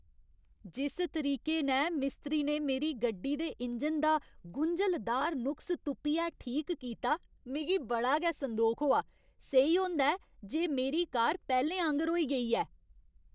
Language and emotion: Dogri, happy